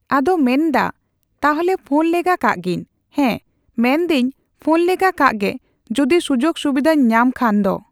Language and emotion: Santali, neutral